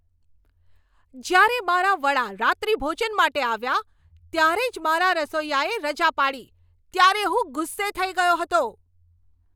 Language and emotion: Gujarati, angry